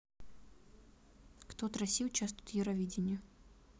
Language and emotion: Russian, neutral